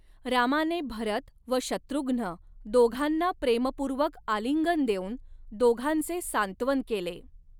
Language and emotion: Marathi, neutral